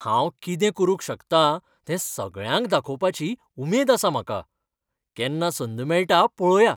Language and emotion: Goan Konkani, happy